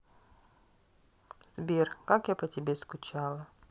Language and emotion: Russian, sad